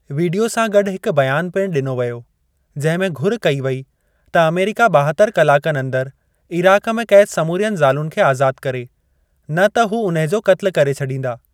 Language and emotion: Sindhi, neutral